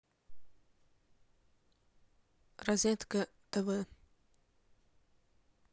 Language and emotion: Russian, neutral